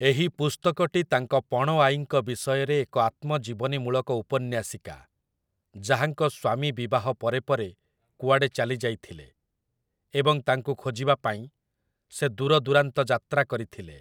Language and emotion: Odia, neutral